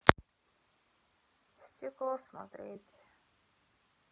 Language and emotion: Russian, sad